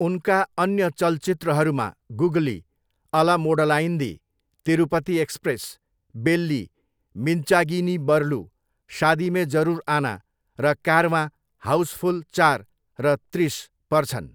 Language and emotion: Nepali, neutral